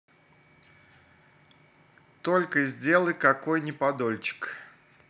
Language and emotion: Russian, neutral